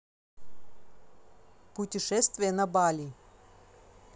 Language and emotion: Russian, neutral